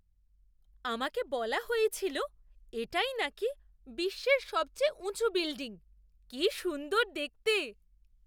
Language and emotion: Bengali, surprised